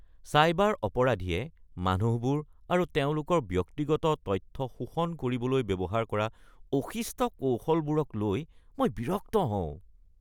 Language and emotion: Assamese, disgusted